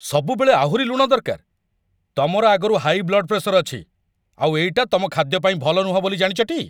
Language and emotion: Odia, angry